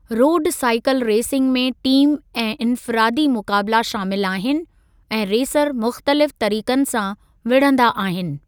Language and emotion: Sindhi, neutral